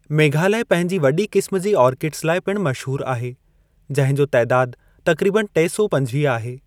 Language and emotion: Sindhi, neutral